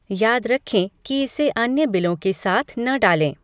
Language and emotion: Hindi, neutral